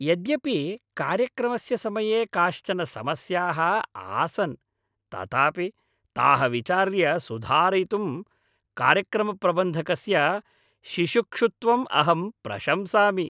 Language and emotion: Sanskrit, happy